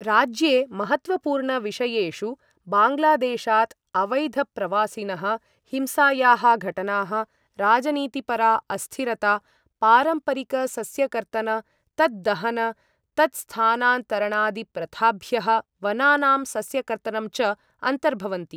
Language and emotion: Sanskrit, neutral